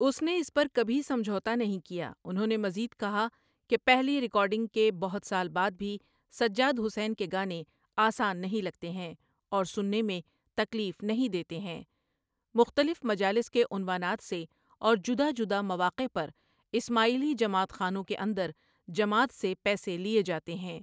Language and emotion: Urdu, neutral